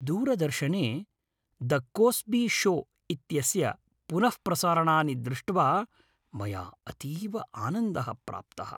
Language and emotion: Sanskrit, happy